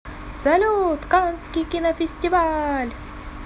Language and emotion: Russian, positive